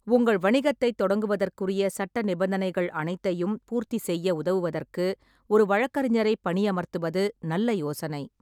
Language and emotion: Tamil, neutral